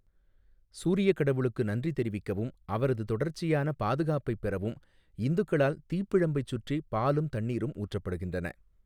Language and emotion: Tamil, neutral